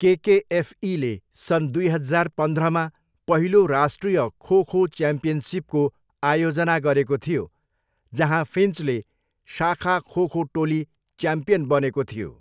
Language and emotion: Nepali, neutral